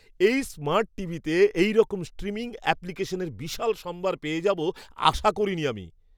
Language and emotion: Bengali, surprised